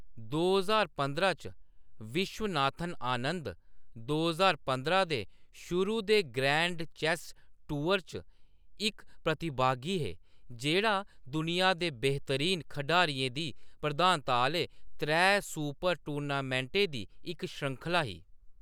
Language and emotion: Dogri, neutral